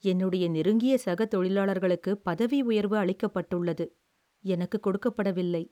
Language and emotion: Tamil, sad